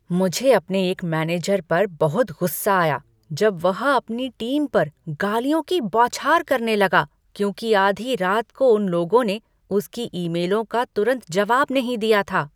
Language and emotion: Hindi, angry